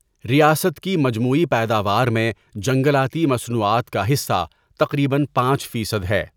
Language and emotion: Urdu, neutral